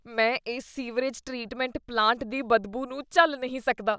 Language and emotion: Punjabi, disgusted